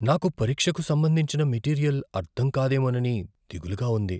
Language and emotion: Telugu, fearful